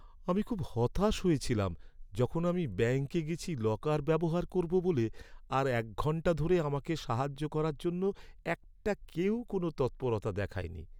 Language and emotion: Bengali, sad